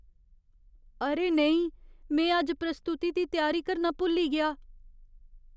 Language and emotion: Dogri, fearful